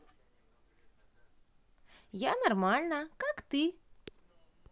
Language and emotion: Russian, positive